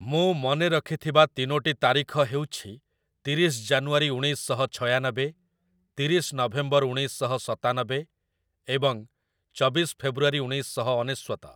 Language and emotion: Odia, neutral